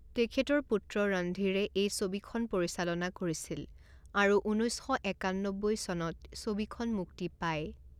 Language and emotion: Assamese, neutral